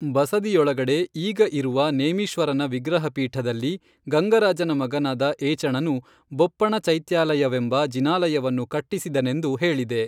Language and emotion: Kannada, neutral